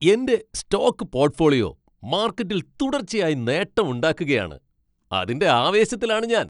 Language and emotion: Malayalam, happy